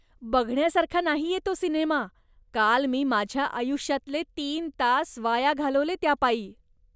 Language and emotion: Marathi, disgusted